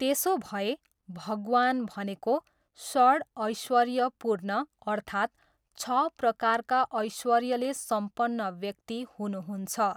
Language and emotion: Nepali, neutral